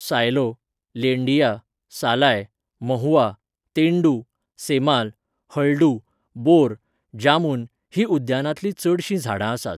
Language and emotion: Goan Konkani, neutral